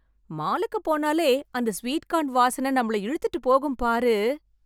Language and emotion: Tamil, happy